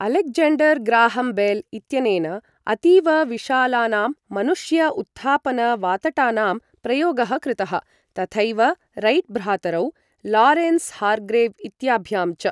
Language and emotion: Sanskrit, neutral